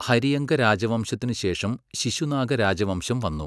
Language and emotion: Malayalam, neutral